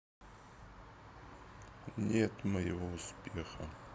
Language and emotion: Russian, sad